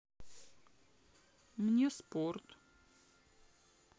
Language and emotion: Russian, sad